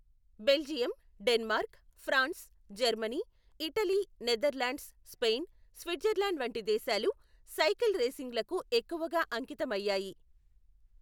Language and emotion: Telugu, neutral